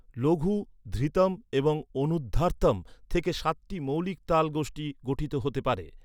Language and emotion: Bengali, neutral